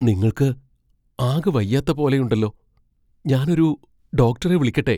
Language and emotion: Malayalam, fearful